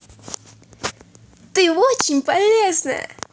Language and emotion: Russian, positive